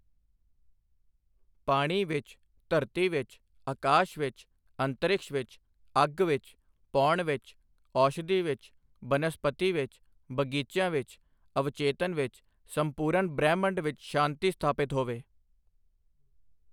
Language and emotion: Punjabi, neutral